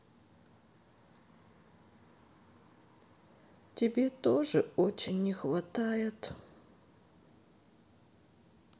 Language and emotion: Russian, sad